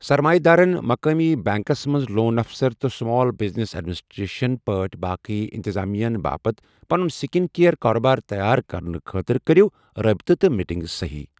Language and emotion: Kashmiri, neutral